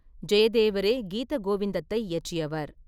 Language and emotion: Tamil, neutral